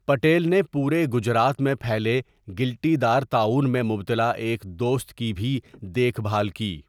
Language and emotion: Urdu, neutral